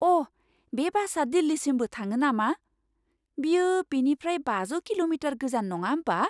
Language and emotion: Bodo, surprised